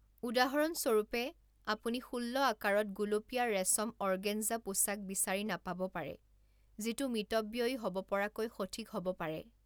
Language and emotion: Assamese, neutral